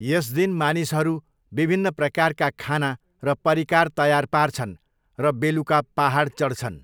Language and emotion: Nepali, neutral